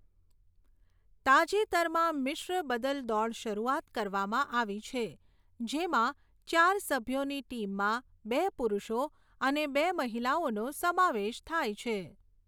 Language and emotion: Gujarati, neutral